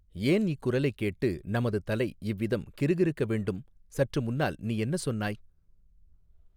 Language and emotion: Tamil, neutral